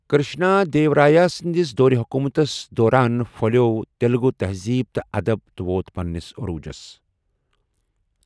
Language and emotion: Kashmiri, neutral